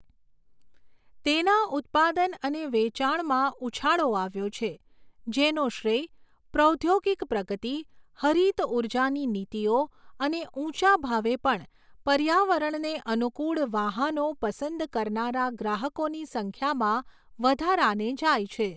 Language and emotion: Gujarati, neutral